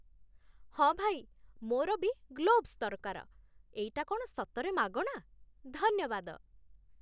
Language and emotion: Odia, happy